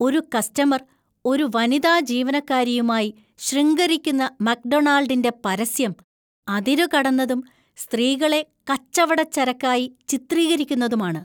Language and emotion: Malayalam, disgusted